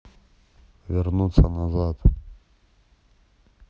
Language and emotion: Russian, neutral